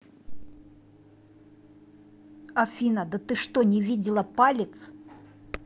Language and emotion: Russian, angry